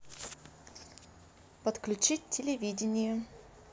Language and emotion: Russian, neutral